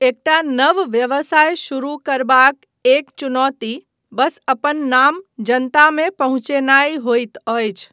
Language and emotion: Maithili, neutral